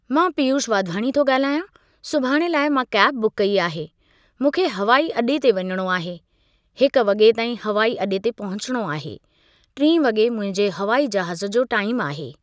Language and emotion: Sindhi, neutral